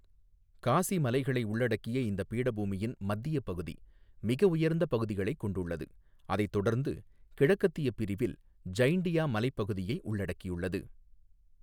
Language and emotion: Tamil, neutral